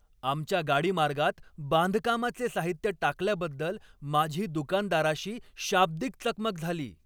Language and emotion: Marathi, angry